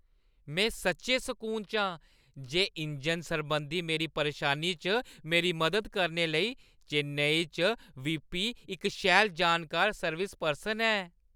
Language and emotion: Dogri, happy